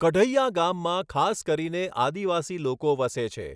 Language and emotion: Gujarati, neutral